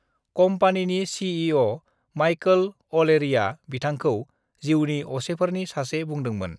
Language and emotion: Bodo, neutral